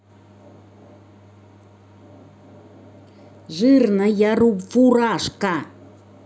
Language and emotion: Russian, angry